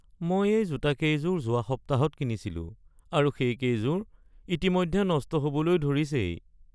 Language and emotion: Assamese, sad